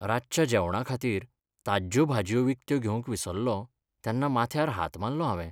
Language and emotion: Goan Konkani, sad